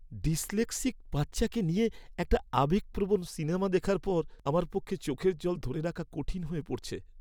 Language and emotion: Bengali, sad